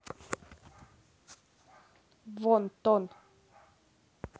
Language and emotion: Russian, angry